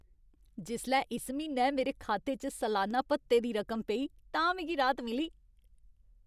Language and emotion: Dogri, happy